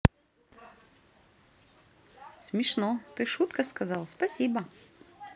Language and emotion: Russian, positive